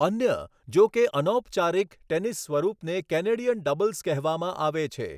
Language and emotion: Gujarati, neutral